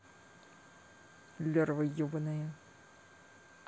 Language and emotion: Russian, angry